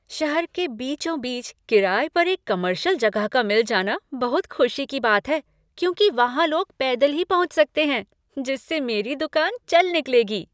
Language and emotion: Hindi, happy